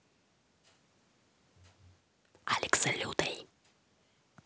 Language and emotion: Russian, neutral